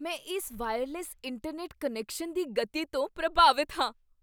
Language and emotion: Punjabi, surprised